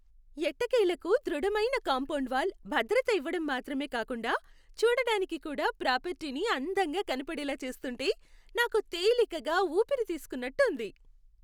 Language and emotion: Telugu, happy